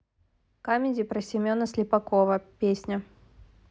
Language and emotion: Russian, neutral